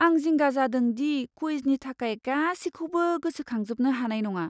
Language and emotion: Bodo, fearful